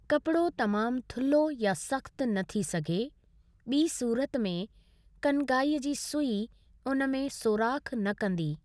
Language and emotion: Sindhi, neutral